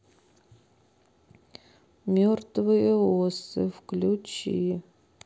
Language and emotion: Russian, neutral